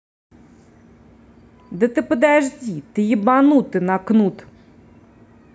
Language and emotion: Russian, angry